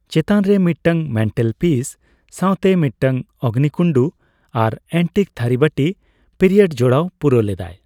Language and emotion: Santali, neutral